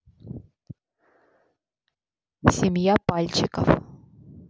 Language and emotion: Russian, neutral